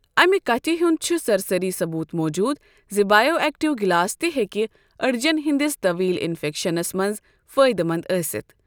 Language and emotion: Kashmiri, neutral